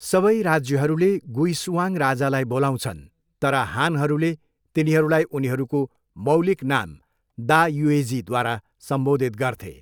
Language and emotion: Nepali, neutral